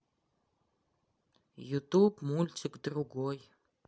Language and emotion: Russian, neutral